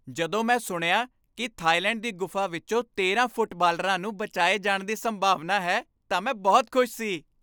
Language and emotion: Punjabi, happy